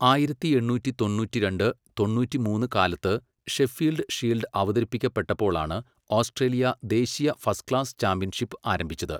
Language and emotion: Malayalam, neutral